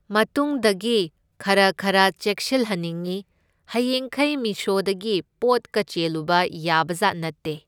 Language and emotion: Manipuri, neutral